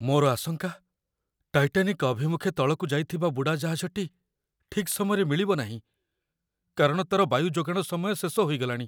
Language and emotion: Odia, fearful